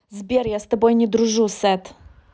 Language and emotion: Russian, angry